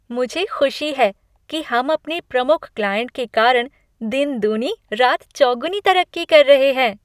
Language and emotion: Hindi, happy